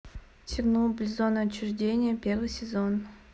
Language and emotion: Russian, neutral